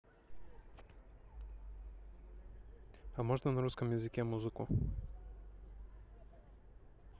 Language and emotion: Russian, neutral